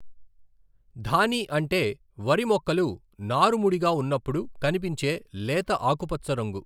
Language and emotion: Telugu, neutral